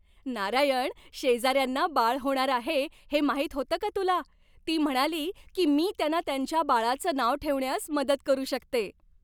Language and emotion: Marathi, happy